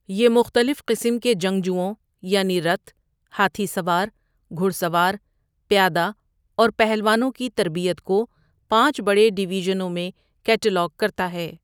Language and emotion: Urdu, neutral